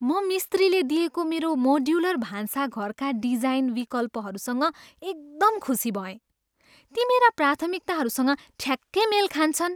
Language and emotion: Nepali, happy